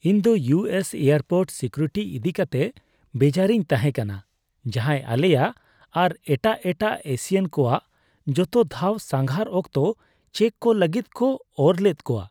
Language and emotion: Santali, disgusted